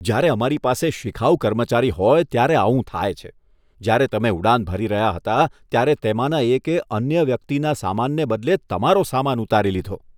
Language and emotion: Gujarati, disgusted